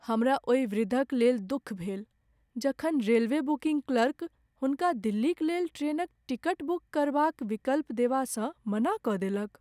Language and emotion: Maithili, sad